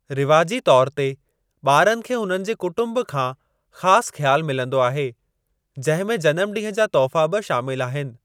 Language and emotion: Sindhi, neutral